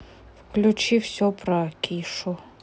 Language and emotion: Russian, neutral